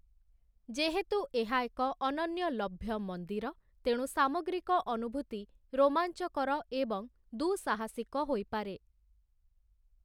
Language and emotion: Odia, neutral